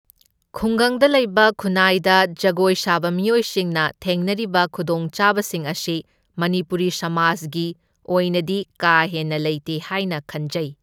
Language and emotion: Manipuri, neutral